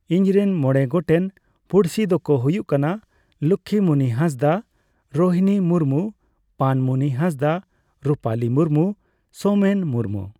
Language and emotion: Santali, neutral